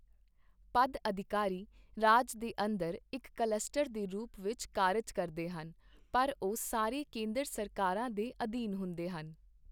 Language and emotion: Punjabi, neutral